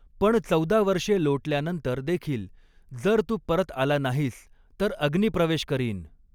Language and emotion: Marathi, neutral